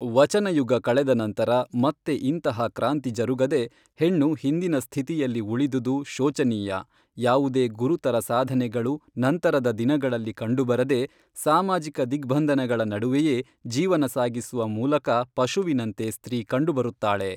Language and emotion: Kannada, neutral